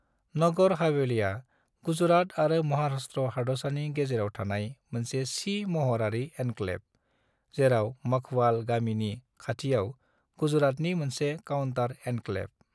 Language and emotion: Bodo, neutral